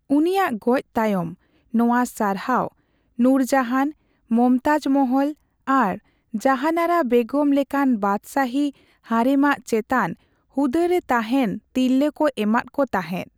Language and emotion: Santali, neutral